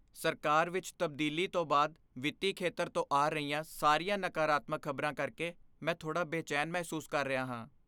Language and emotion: Punjabi, fearful